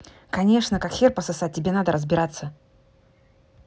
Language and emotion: Russian, angry